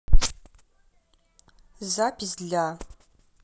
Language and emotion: Russian, neutral